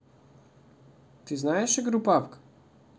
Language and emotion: Russian, neutral